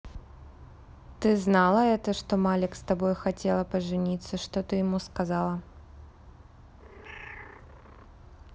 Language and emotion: Russian, neutral